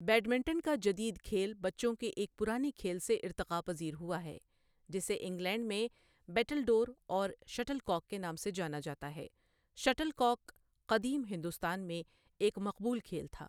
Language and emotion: Urdu, neutral